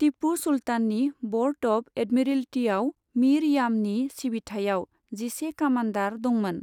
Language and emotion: Bodo, neutral